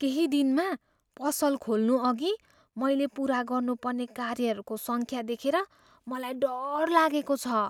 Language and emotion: Nepali, fearful